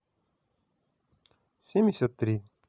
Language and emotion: Russian, positive